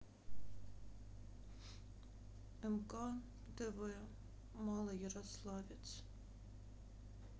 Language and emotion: Russian, sad